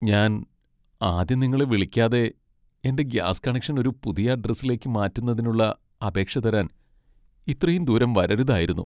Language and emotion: Malayalam, sad